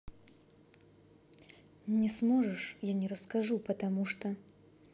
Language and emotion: Russian, neutral